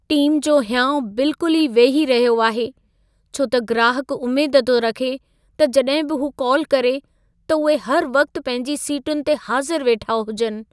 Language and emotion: Sindhi, sad